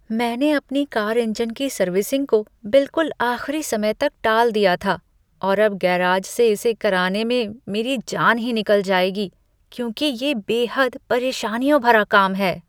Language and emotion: Hindi, disgusted